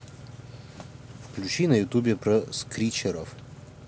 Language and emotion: Russian, neutral